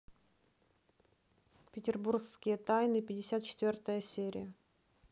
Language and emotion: Russian, neutral